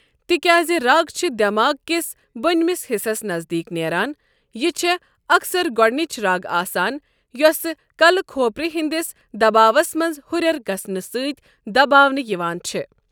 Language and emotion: Kashmiri, neutral